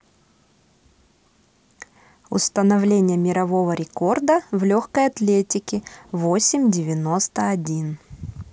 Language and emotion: Russian, neutral